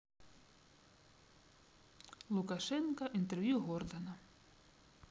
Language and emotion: Russian, neutral